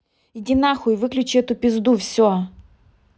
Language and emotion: Russian, angry